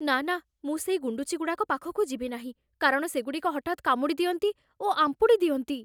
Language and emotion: Odia, fearful